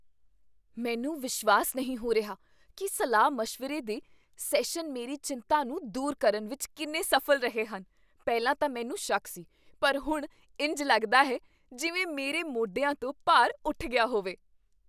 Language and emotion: Punjabi, surprised